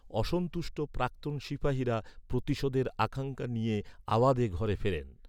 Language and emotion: Bengali, neutral